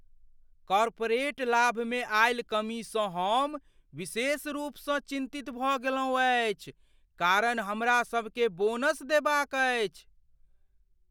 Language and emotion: Maithili, fearful